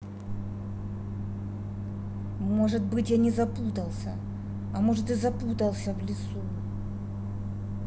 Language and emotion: Russian, angry